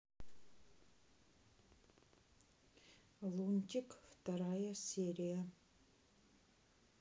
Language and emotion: Russian, neutral